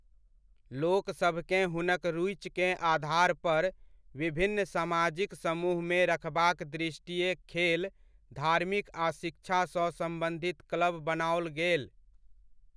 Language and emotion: Maithili, neutral